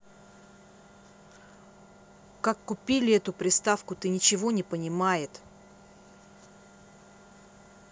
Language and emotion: Russian, angry